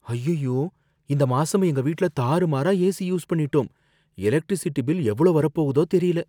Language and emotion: Tamil, fearful